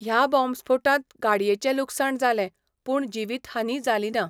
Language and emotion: Goan Konkani, neutral